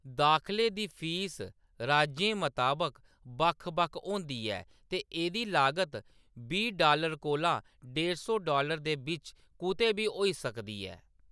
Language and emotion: Dogri, neutral